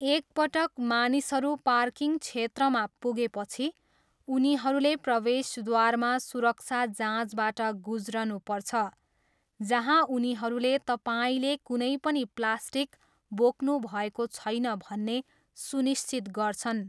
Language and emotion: Nepali, neutral